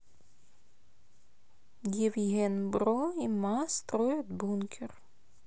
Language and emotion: Russian, neutral